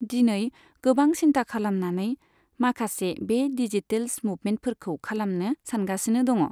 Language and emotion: Bodo, neutral